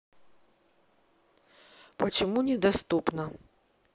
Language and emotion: Russian, neutral